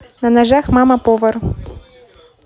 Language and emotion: Russian, positive